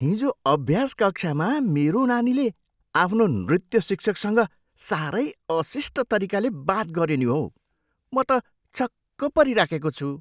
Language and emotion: Nepali, surprised